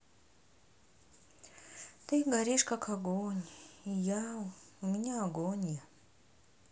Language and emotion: Russian, sad